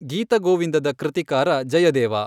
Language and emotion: Kannada, neutral